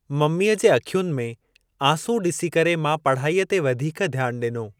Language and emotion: Sindhi, neutral